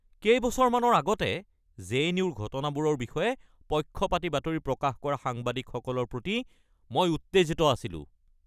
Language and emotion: Assamese, angry